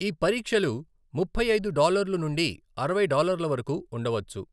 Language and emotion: Telugu, neutral